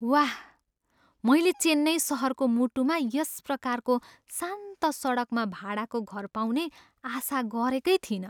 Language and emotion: Nepali, surprised